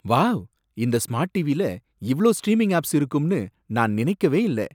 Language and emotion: Tamil, surprised